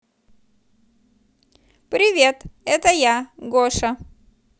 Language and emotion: Russian, positive